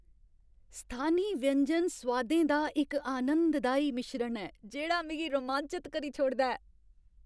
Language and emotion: Dogri, happy